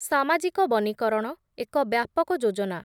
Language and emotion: Odia, neutral